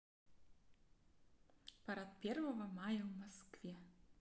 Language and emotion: Russian, positive